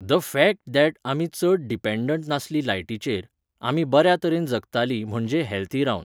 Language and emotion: Goan Konkani, neutral